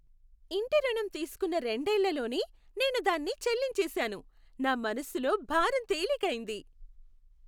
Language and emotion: Telugu, happy